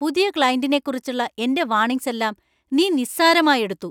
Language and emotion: Malayalam, angry